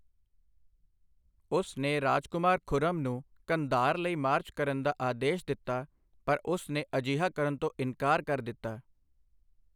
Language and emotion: Punjabi, neutral